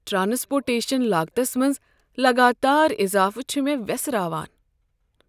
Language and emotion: Kashmiri, sad